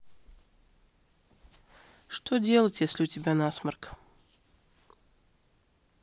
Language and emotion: Russian, neutral